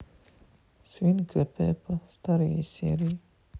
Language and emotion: Russian, sad